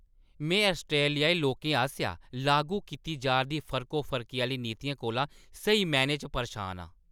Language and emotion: Dogri, angry